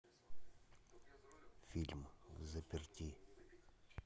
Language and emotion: Russian, neutral